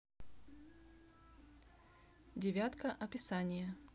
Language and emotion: Russian, neutral